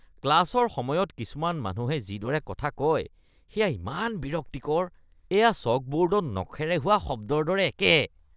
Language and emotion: Assamese, disgusted